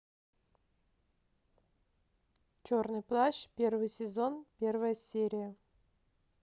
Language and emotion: Russian, neutral